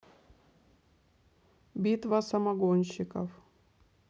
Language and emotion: Russian, neutral